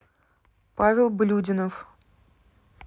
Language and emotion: Russian, neutral